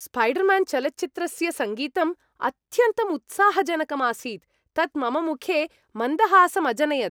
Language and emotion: Sanskrit, happy